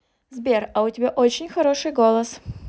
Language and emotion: Russian, positive